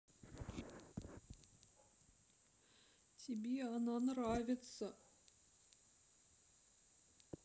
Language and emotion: Russian, sad